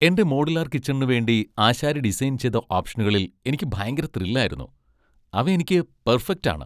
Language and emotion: Malayalam, happy